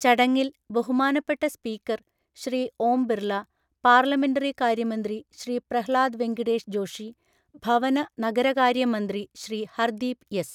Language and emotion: Malayalam, neutral